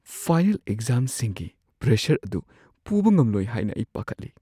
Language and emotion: Manipuri, fearful